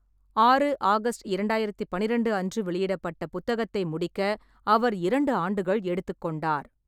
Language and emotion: Tamil, neutral